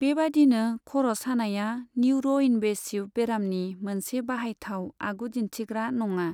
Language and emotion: Bodo, neutral